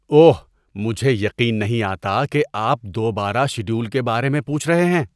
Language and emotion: Urdu, disgusted